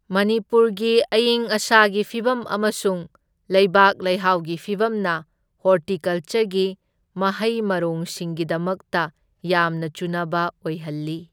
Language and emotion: Manipuri, neutral